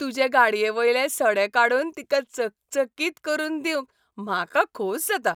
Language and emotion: Goan Konkani, happy